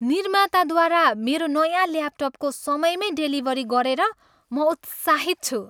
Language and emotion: Nepali, happy